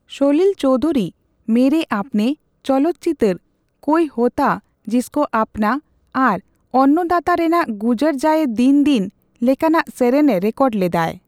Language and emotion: Santali, neutral